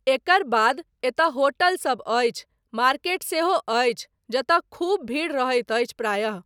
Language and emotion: Maithili, neutral